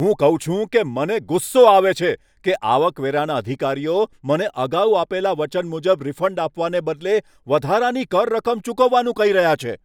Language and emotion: Gujarati, angry